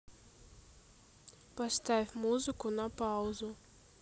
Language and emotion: Russian, neutral